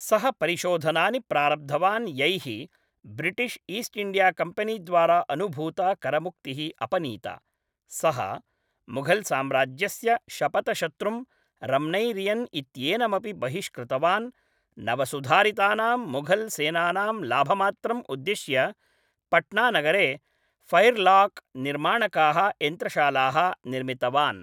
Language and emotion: Sanskrit, neutral